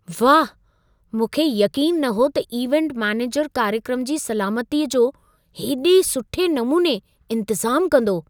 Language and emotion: Sindhi, surprised